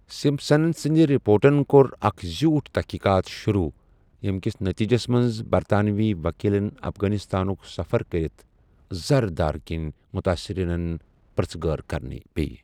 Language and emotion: Kashmiri, neutral